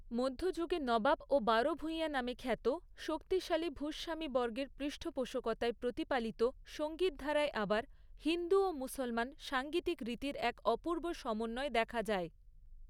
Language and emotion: Bengali, neutral